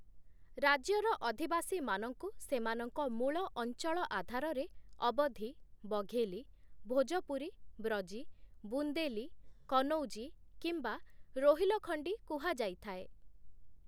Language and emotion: Odia, neutral